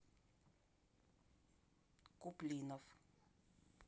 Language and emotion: Russian, neutral